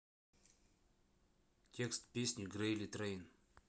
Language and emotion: Russian, neutral